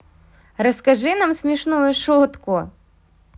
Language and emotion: Russian, positive